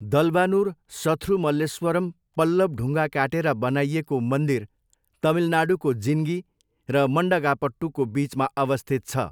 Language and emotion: Nepali, neutral